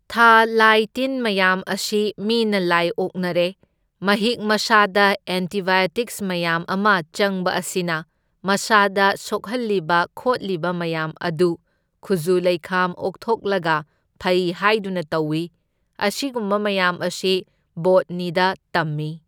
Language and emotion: Manipuri, neutral